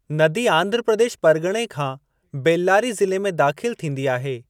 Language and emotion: Sindhi, neutral